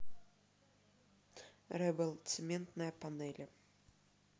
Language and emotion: Russian, neutral